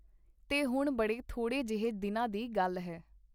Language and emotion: Punjabi, neutral